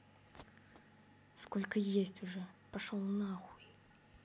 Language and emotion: Russian, angry